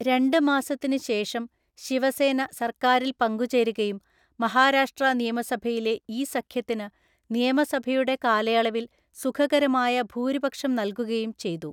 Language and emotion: Malayalam, neutral